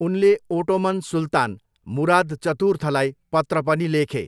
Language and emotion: Nepali, neutral